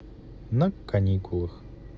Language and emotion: Russian, positive